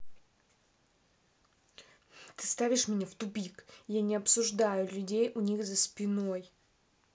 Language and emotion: Russian, angry